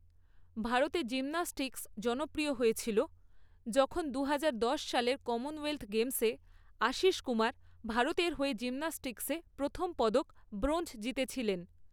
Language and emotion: Bengali, neutral